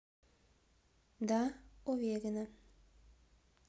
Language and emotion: Russian, neutral